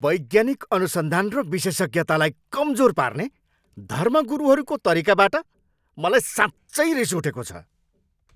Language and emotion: Nepali, angry